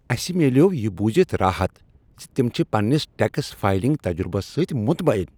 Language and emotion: Kashmiri, happy